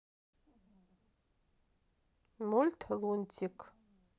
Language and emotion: Russian, neutral